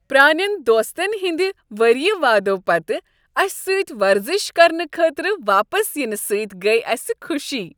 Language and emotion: Kashmiri, happy